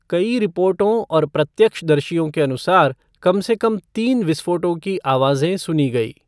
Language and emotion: Hindi, neutral